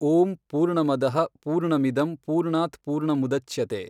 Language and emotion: Kannada, neutral